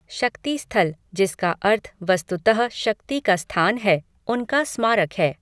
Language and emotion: Hindi, neutral